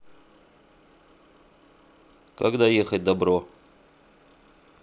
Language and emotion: Russian, neutral